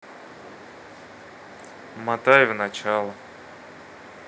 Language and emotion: Russian, neutral